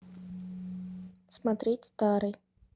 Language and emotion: Russian, neutral